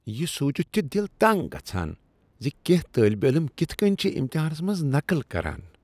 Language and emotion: Kashmiri, disgusted